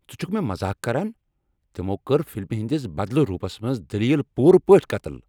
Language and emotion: Kashmiri, angry